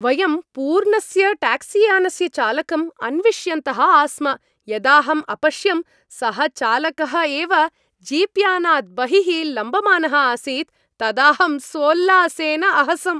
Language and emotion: Sanskrit, happy